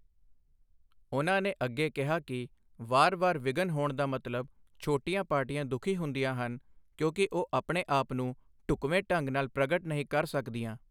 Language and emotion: Punjabi, neutral